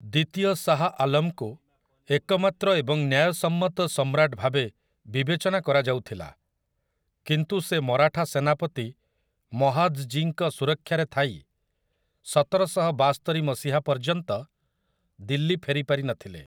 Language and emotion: Odia, neutral